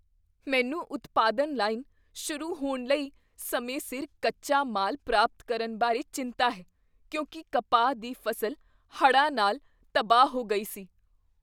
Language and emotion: Punjabi, fearful